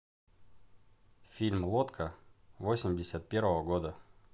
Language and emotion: Russian, neutral